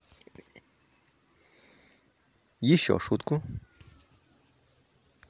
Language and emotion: Russian, neutral